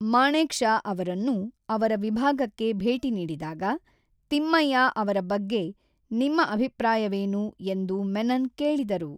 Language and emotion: Kannada, neutral